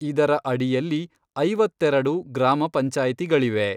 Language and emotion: Kannada, neutral